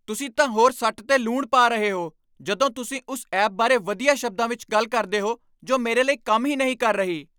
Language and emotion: Punjabi, angry